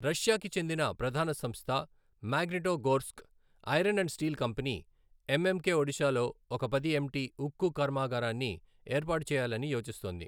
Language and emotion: Telugu, neutral